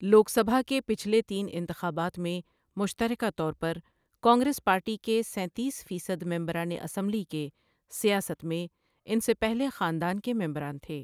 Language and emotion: Urdu, neutral